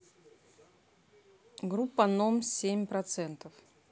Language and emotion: Russian, neutral